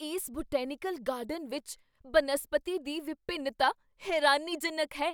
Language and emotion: Punjabi, surprised